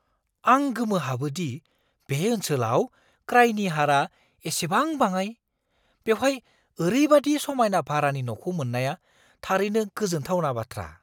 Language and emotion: Bodo, surprised